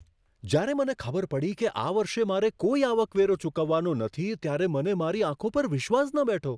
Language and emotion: Gujarati, surprised